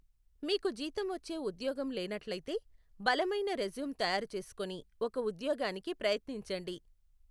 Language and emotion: Telugu, neutral